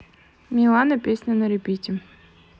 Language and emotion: Russian, neutral